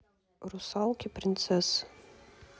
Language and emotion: Russian, neutral